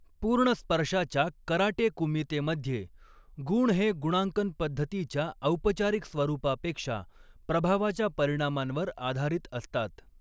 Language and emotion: Marathi, neutral